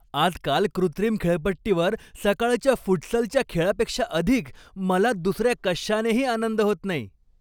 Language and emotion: Marathi, happy